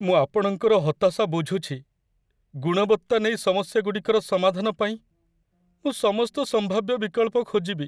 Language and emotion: Odia, sad